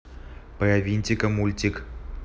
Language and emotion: Russian, neutral